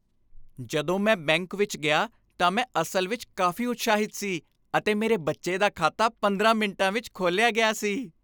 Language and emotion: Punjabi, happy